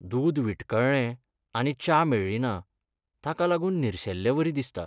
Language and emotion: Goan Konkani, sad